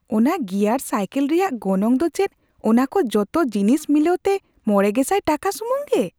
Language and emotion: Santali, surprised